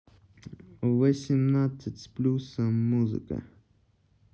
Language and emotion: Russian, neutral